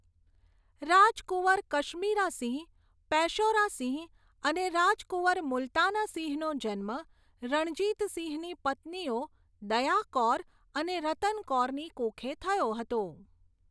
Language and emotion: Gujarati, neutral